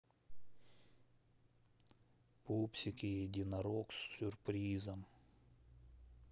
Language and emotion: Russian, neutral